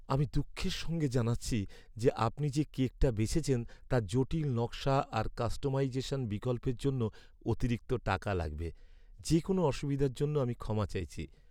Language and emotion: Bengali, sad